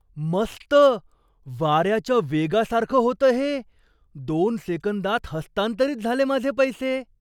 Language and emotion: Marathi, surprised